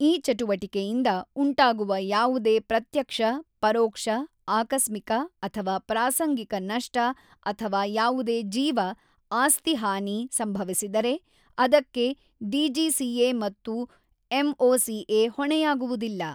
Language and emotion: Kannada, neutral